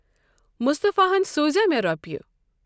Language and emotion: Kashmiri, neutral